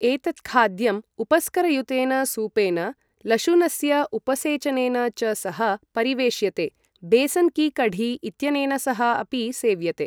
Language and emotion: Sanskrit, neutral